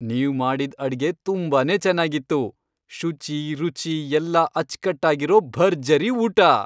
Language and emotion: Kannada, happy